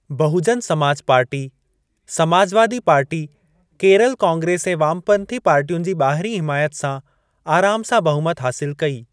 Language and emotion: Sindhi, neutral